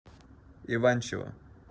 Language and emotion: Russian, neutral